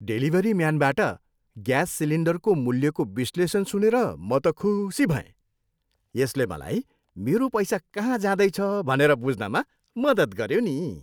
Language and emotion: Nepali, happy